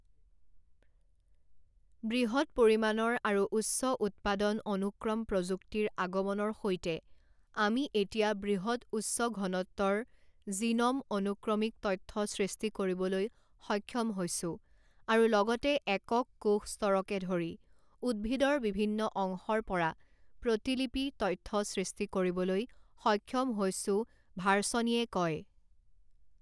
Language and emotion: Assamese, neutral